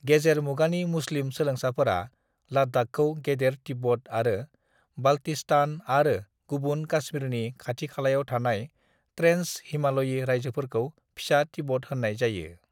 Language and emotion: Bodo, neutral